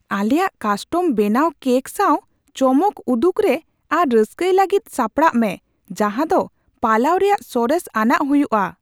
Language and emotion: Santali, surprised